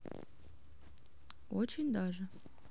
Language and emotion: Russian, neutral